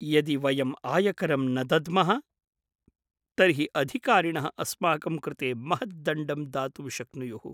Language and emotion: Sanskrit, fearful